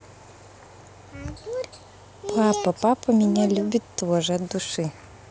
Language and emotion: Russian, positive